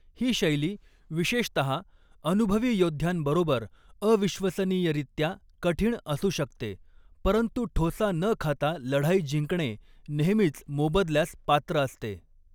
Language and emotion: Marathi, neutral